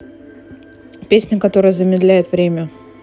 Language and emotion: Russian, neutral